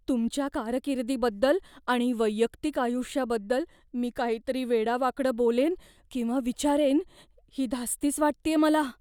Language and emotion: Marathi, fearful